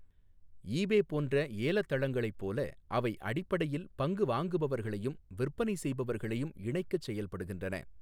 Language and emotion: Tamil, neutral